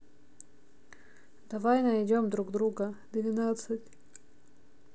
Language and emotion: Russian, neutral